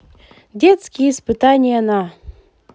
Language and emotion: Russian, positive